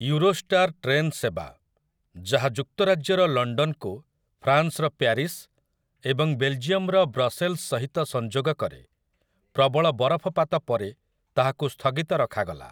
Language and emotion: Odia, neutral